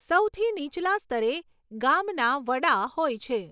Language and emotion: Gujarati, neutral